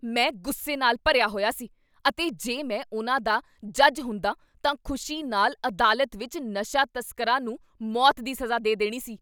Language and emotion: Punjabi, angry